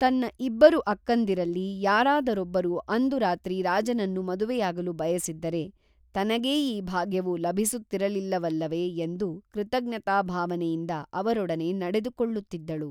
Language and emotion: Kannada, neutral